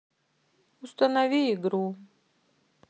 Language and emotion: Russian, sad